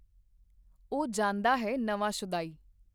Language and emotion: Punjabi, neutral